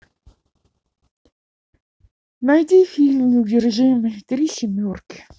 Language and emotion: Russian, sad